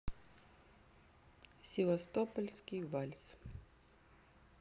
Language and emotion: Russian, neutral